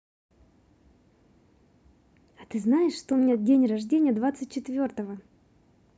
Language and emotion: Russian, positive